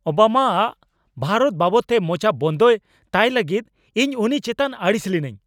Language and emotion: Santali, angry